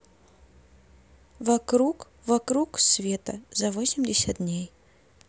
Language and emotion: Russian, neutral